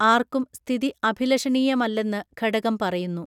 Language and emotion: Malayalam, neutral